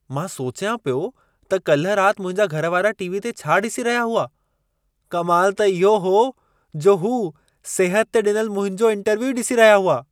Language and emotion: Sindhi, surprised